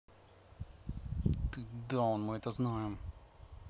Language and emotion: Russian, angry